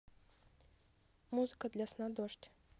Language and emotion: Russian, neutral